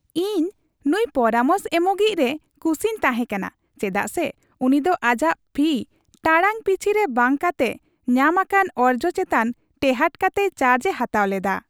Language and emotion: Santali, happy